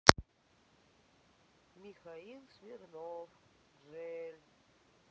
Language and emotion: Russian, sad